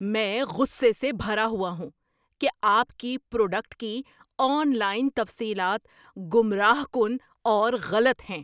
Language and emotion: Urdu, angry